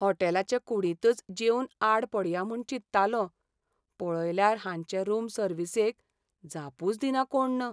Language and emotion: Goan Konkani, sad